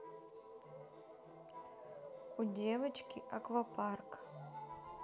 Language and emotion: Russian, neutral